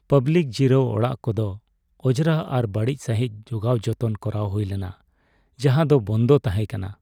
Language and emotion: Santali, sad